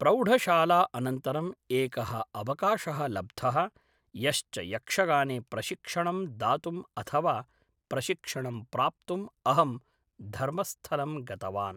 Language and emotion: Sanskrit, neutral